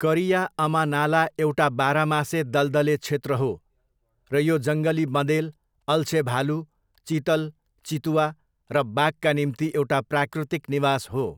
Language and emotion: Nepali, neutral